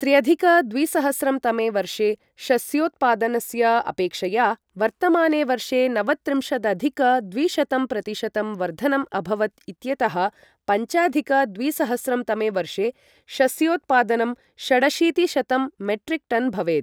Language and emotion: Sanskrit, neutral